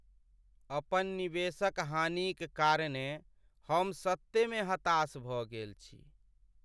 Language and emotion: Maithili, sad